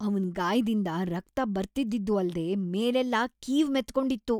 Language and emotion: Kannada, disgusted